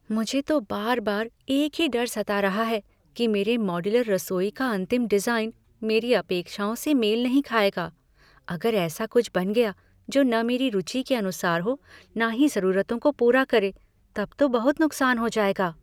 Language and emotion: Hindi, fearful